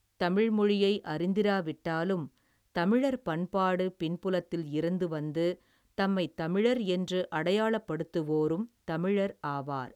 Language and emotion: Tamil, neutral